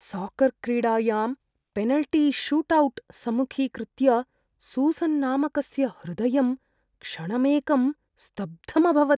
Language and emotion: Sanskrit, fearful